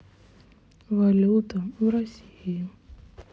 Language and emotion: Russian, sad